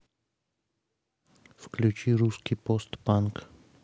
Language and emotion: Russian, neutral